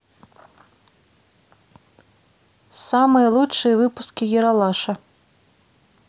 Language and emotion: Russian, neutral